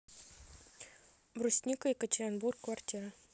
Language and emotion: Russian, neutral